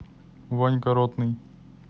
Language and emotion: Russian, neutral